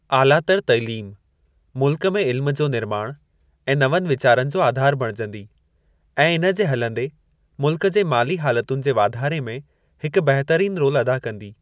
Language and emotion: Sindhi, neutral